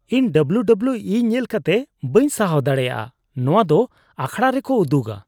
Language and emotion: Santali, disgusted